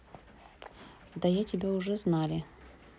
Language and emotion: Russian, neutral